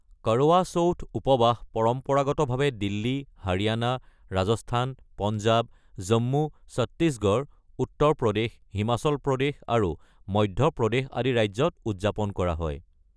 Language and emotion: Assamese, neutral